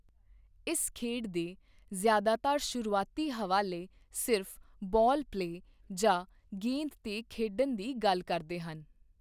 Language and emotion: Punjabi, neutral